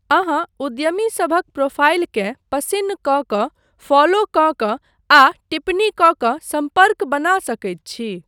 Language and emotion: Maithili, neutral